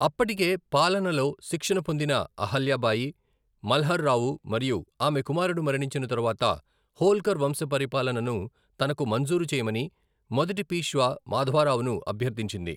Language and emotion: Telugu, neutral